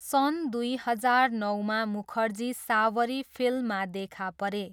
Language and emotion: Nepali, neutral